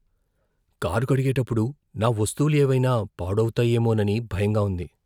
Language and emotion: Telugu, fearful